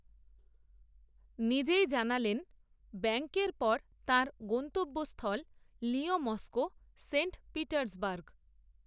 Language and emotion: Bengali, neutral